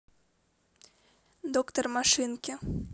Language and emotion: Russian, neutral